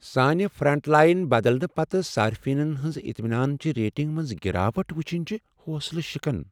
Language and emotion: Kashmiri, sad